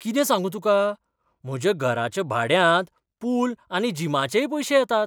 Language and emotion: Goan Konkani, surprised